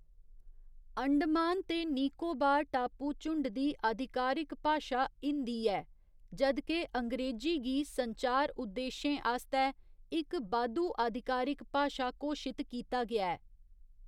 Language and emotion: Dogri, neutral